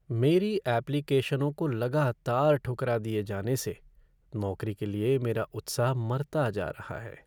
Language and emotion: Hindi, sad